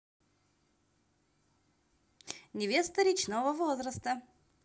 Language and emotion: Russian, positive